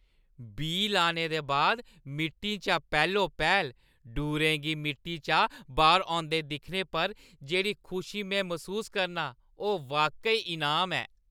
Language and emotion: Dogri, happy